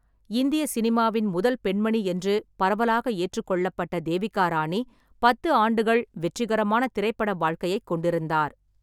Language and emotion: Tamil, neutral